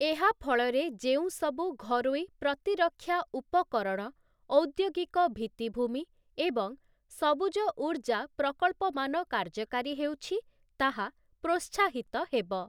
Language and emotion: Odia, neutral